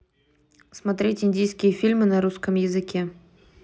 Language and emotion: Russian, neutral